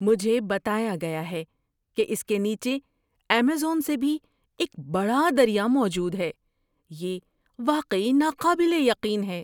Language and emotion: Urdu, surprised